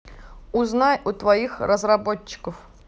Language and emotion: Russian, neutral